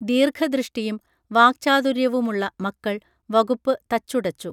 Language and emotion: Malayalam, neutral